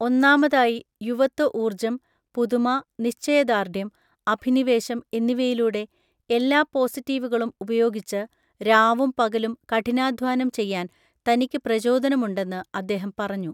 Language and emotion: Malayalam, neutral